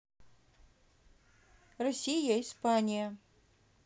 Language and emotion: Russian, neutral